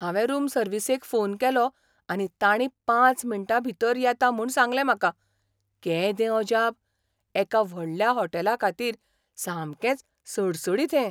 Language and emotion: Goan Konkani, surprised